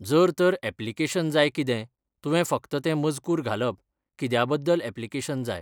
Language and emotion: Goan Konkani, neutral